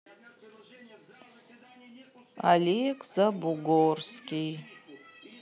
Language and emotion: Russian, sad